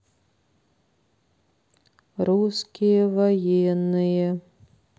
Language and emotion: Russian, neutral